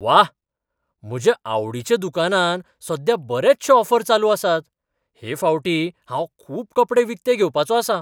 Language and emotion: Goan Konkani, surprised